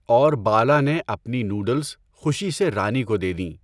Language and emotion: Urdu, neutral